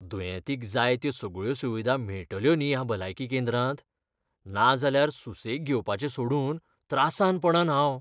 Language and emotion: Goan Konkani, fearful